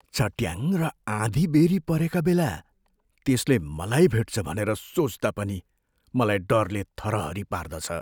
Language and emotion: Nepali, fearful